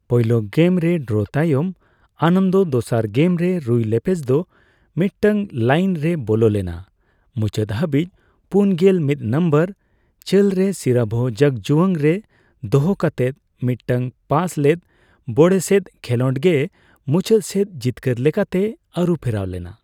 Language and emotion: Santali, neutral